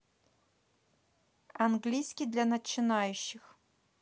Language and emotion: Russian, neutral